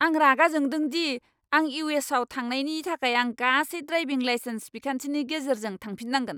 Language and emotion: Bodo, angry